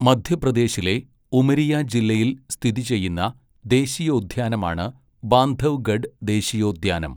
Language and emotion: Malayalam, neutral